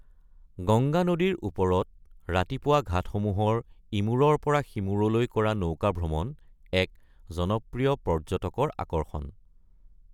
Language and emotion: Assamese, neutral